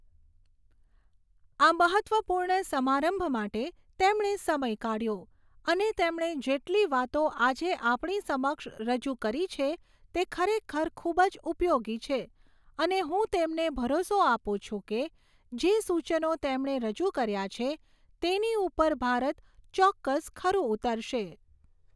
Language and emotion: Gujarati, neutral